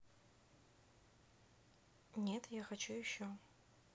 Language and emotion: Russian, neutral